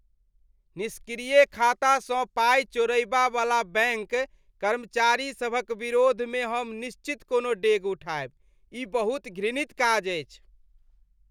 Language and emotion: Maithili, disgusted